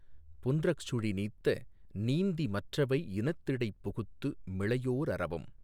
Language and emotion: Tamil, neutral